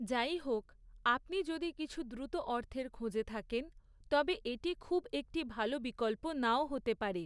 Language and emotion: Bengali, neutral